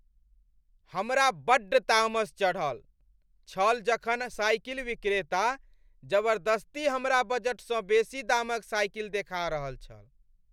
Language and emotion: Maithili, angry